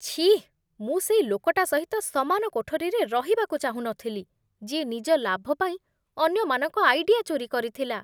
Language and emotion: Odia, disgusted